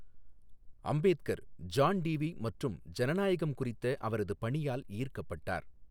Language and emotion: Tamil, neutral